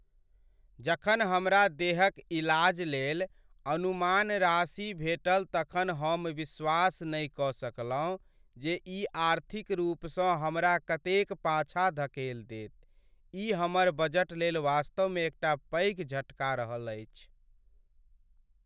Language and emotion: Maithili, sad